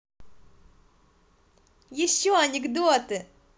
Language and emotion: Russian, positive